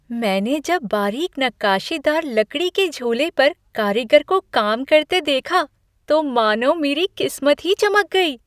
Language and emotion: Hindi, happy